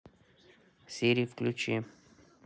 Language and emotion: Russian, neutral